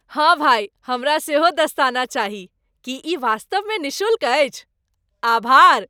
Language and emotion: Maithili, happy